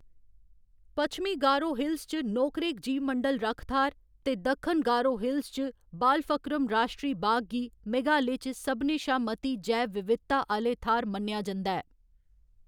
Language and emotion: Dogri, neutral